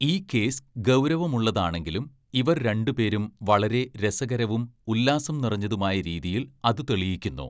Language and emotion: Malayalam, neutral